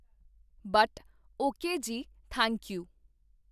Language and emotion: Punjabi, neutral